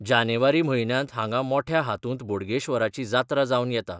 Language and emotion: Goan Konkani, neutral